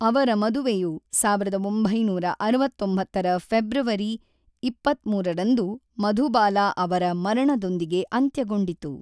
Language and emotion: Kannada, neutral